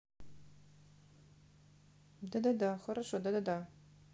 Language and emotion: Russian, neutral